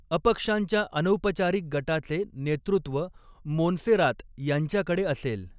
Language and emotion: Marathi, neutral